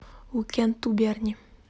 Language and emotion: Russian, neutral